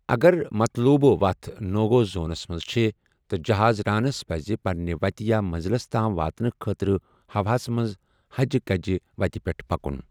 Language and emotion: Kashmiri, neutral